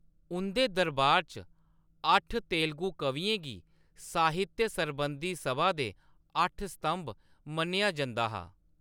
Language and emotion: Dogri, neutral